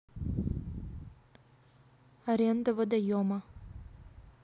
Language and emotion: Russian, neutral